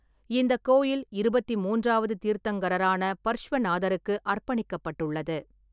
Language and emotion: Tamil, neutral